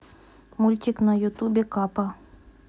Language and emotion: Russian, neutral